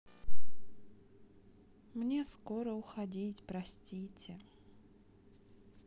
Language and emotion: Russian, sad